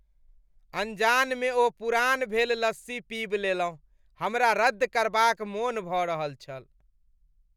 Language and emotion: Maithili, disgusted